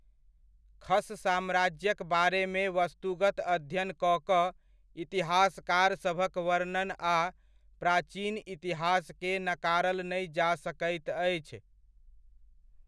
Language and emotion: Maithili, neutral